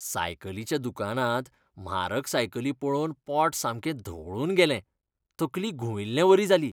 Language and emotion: Goan Konkani, disgusted